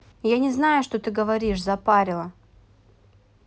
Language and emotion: Russian, angry